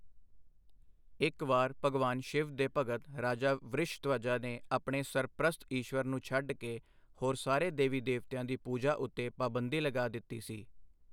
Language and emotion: Punjabi, neutral